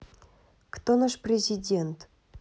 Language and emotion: Russian, neutral